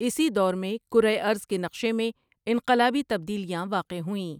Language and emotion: Urdu, neutral